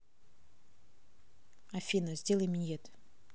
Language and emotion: Russian, neutral